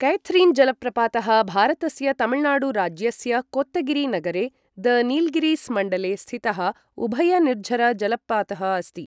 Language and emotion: Sanskrit, neutral